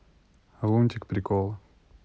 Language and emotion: Russian, neutral